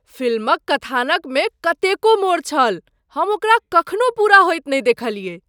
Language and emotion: Maithili, surprised